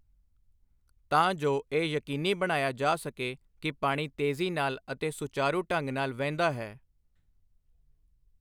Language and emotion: Punjabi, neutral